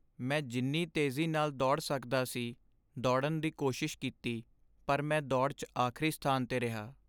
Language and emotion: Punjabi, sad